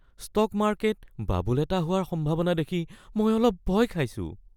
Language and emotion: Assamese, fearful